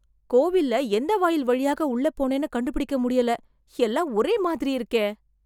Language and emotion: Tamil, surprised